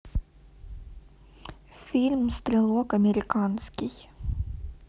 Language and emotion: Russian, neutral